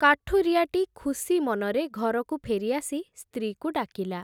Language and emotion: Odia, neutral